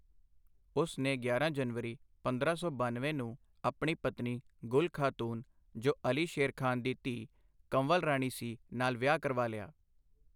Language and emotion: Punjabi, neutral